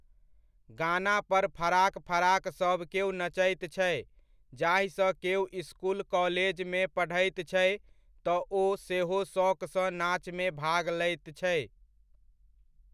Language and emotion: Maithili, neutral